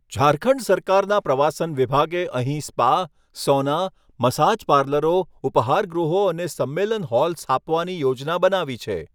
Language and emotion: Gujarati, neutral